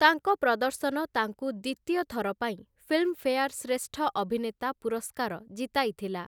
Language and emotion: Odia, neutral